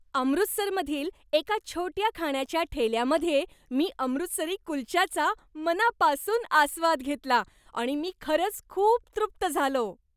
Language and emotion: Marathi, happy